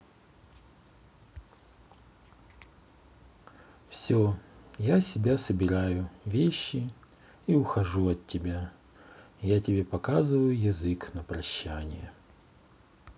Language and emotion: Russian, sad